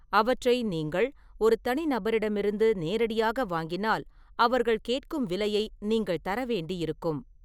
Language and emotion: Tamil, neutral